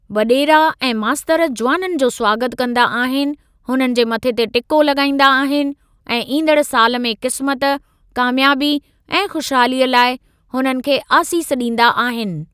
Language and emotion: Sindhi, neutral